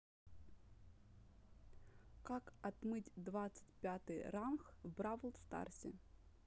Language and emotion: Russian, neutral